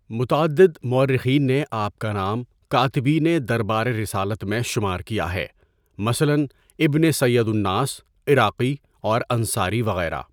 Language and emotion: Urdu, neutral